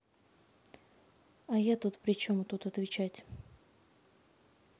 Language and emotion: Russian, neutral